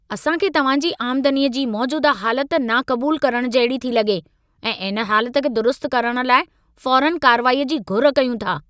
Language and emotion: Sindhi, angry